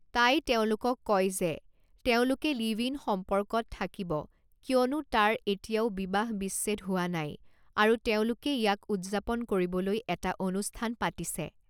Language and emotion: Assamese, neutral